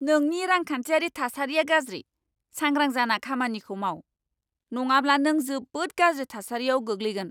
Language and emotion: Bodo, angry